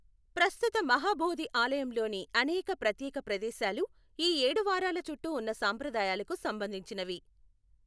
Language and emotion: Telugu, neutral